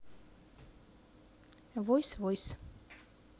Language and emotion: Russian, neutral